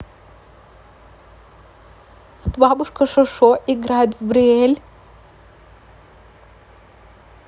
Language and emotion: Russian, neutral